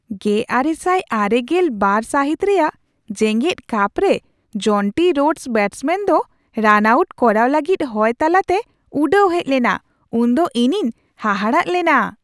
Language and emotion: Santali, surprised